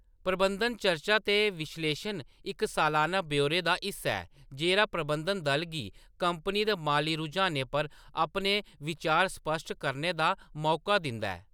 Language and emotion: Dogri, neutral